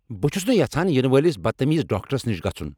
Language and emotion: Kashmiri, angry